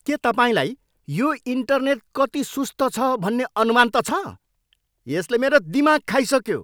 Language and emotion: Nepali, angry